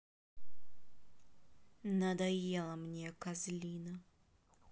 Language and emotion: Russian, angry